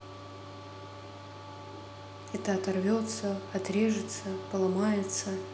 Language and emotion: Russian, neutral